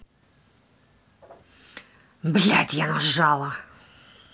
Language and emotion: Russian, angry